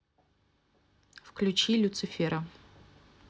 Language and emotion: Russian, neutral